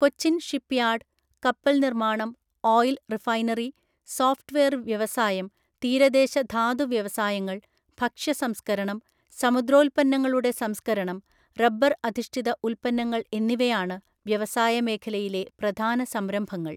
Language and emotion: Malayalam, neutral